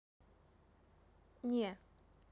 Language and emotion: Russian, neutral